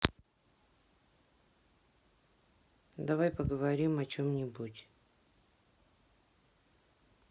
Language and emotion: Russian, sad